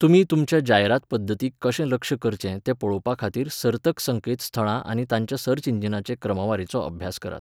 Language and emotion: Goan Konkani, neutral